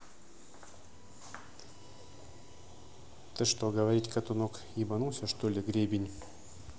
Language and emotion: Russian, angry